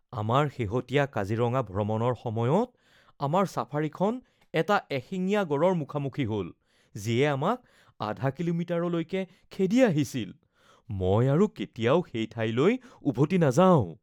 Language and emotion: Assamese, fearful